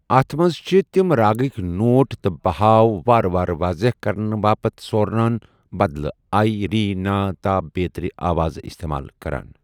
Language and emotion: Kashmiri, neutral